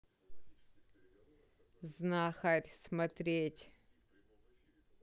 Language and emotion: Russian, neutral